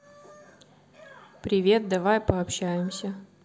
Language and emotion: Russian, neutral